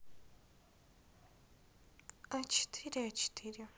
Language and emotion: Russian, neutral